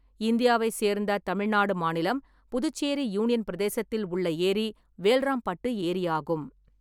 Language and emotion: Tamil, neutral